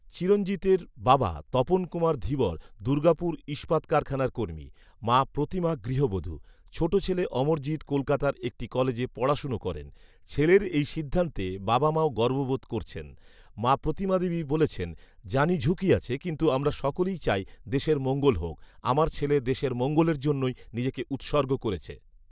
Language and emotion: Bengali, neutral